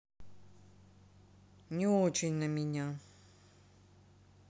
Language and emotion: Russian, sad